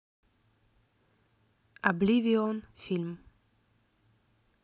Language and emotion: Russian, neutral